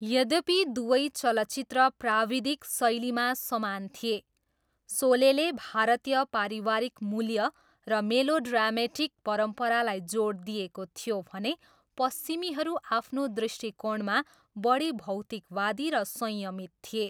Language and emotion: Nepali, neutral